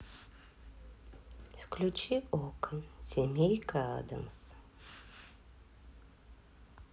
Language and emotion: Russian, neutral